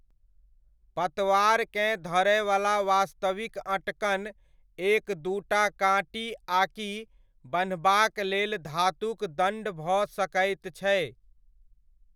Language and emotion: Maithili, neutral